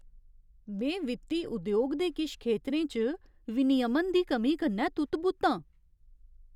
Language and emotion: Dogri, surprised